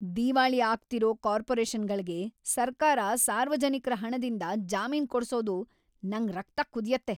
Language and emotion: Kannada, angry